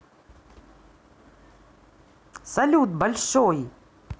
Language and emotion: Russian, positive